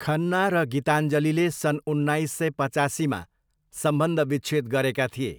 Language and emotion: Nepali, neutral